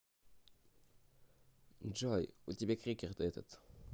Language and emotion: Russian, neutral